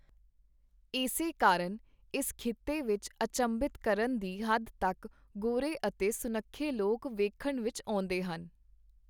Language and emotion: Punjabi, neutral